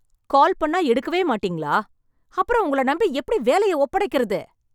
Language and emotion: Tamil, angry